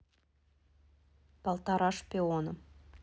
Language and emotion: Russian, neutral